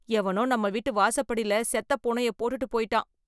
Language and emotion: Tamil, disgusted